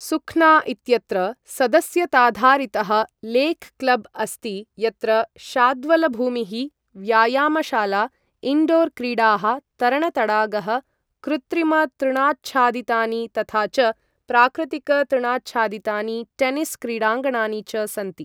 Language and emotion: Sanskrit, neutral